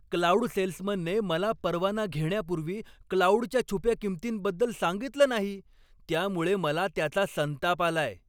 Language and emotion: Marathi, angry